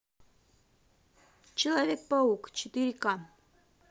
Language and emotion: Russian, neutral